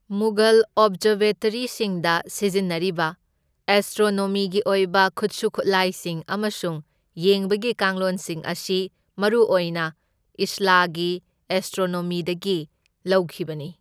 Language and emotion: Manipuri, neutral